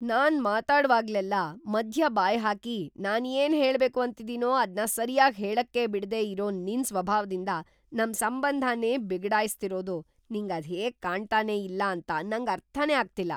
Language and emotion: Kannada, surprised